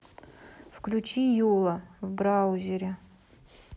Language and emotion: Russian, neutral